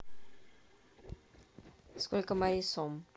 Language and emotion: Russian, neutral